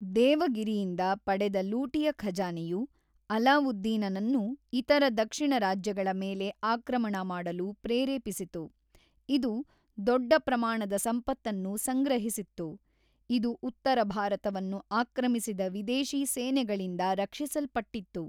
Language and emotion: Kannada, neutral